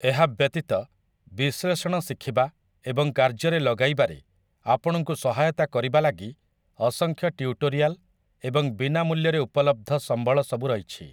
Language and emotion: Odia, neutral